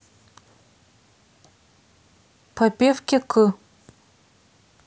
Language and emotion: Russian, neutral